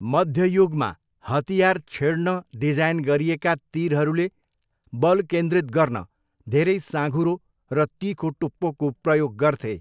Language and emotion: Nepali, neutral